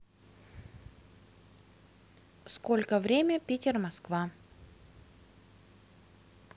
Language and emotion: Russian, neutral